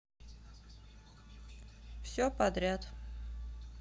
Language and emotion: Russian, neutral